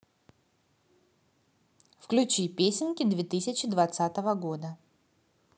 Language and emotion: Russian, positive